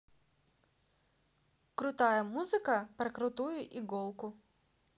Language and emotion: Russian, positive